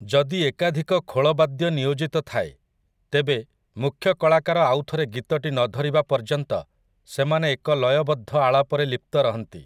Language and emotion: Odia, neutral